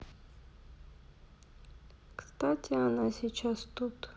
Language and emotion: Russian, sad